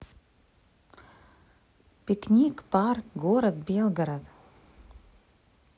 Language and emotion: Russian, positive